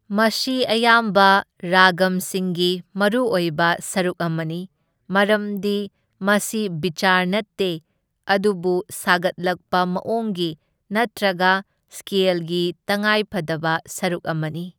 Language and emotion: Manipuri, neutral